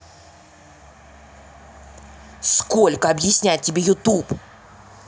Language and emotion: Russian, angry